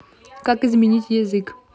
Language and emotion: Russian, neutral